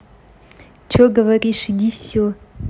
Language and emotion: Russian, angry